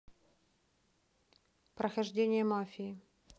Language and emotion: Russian, neutral